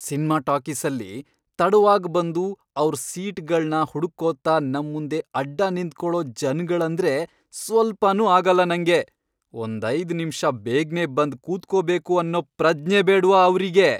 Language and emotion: Kannada, angry